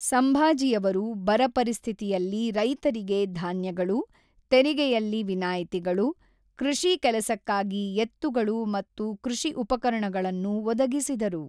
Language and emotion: Kannada, neutral